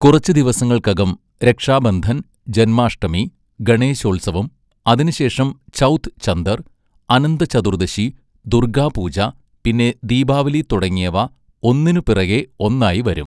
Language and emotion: Malayalam, neutral